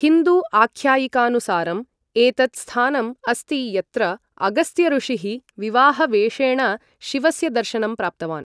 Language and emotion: Sanskrit, neutral